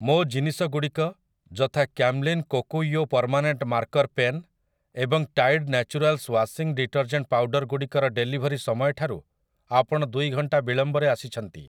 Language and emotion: Odia, neutral